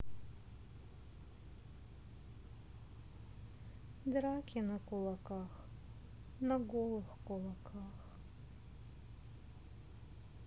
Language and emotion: Russian, sad